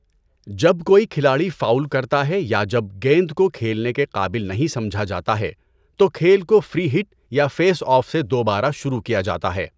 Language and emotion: Urdu, neutral